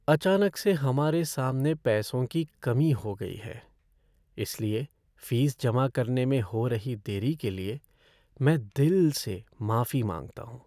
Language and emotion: Hindi, sad